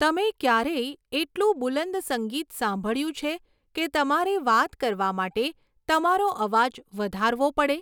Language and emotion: Gujarati, neutral